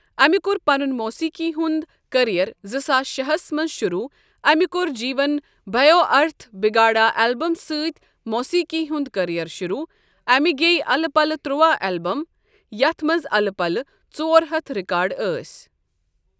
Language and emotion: Kashmiri, neutral